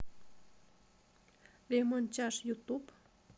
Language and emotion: Russian, neutral